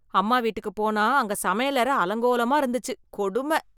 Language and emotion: Tamil, disgusted